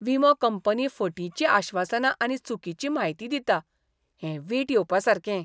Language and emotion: Goan Konkani, disgusted